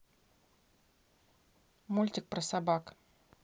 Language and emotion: Russian, neutral